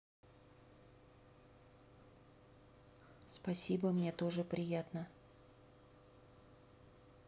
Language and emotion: Russian, neutral